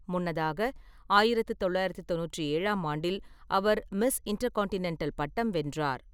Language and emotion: Tamil, neutral